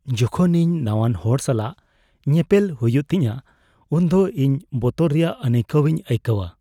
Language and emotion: Santali, fearful